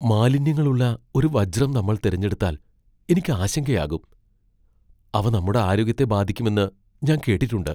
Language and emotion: Malayalam, fearful